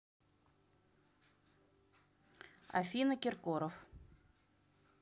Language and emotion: Russian, neutral